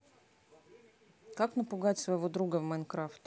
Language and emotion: Russian, neutral